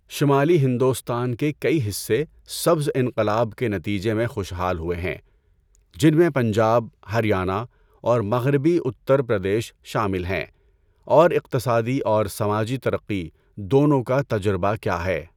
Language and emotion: Urdu, neutral